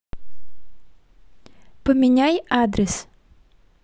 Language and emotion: Russian, positive